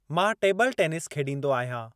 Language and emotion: Sindhi, neutral